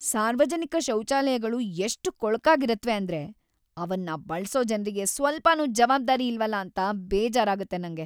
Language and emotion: Kannada, sad